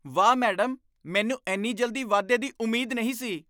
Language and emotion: Punjabi, surprised